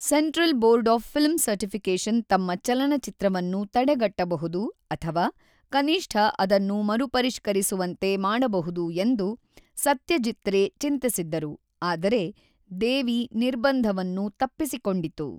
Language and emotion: Kannada, neutral